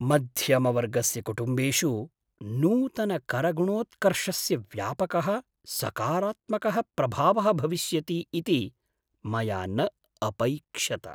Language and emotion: Sanskrit, surprised